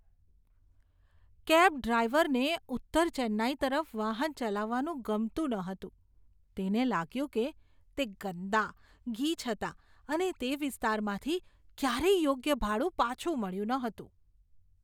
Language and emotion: Gujarati, disgusted